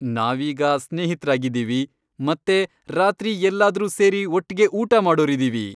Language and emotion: Kannada, happy